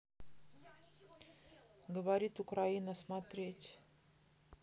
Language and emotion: Russian, neutral